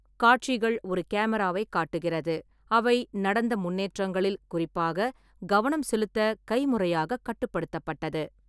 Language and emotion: Tamil, neutral